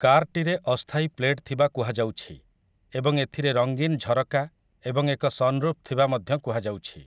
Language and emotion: Odia, neutral